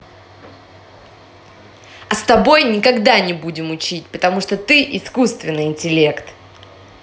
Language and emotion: Russian, angry